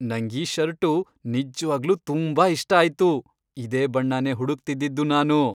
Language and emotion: Kannada, happy